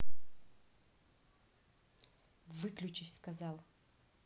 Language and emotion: Russian, angry